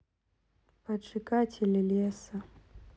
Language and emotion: Russian, sad